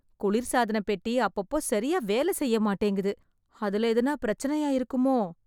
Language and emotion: Tamil, sad